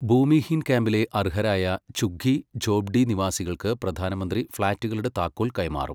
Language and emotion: Malayalam, neutral